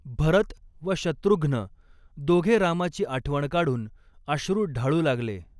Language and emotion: Marathi, neutral